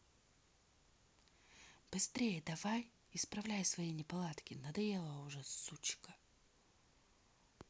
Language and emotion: Russian, angry